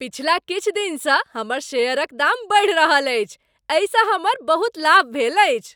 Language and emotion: Maithili, happy